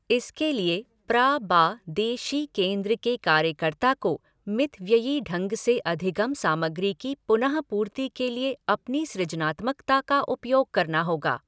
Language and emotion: Hindi, neutral